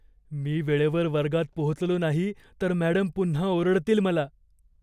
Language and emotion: Marathi, fearful